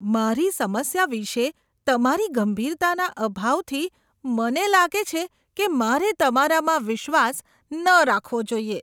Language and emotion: Gujarati, disgusted